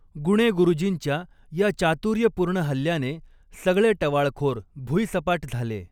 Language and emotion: Marathi, neutral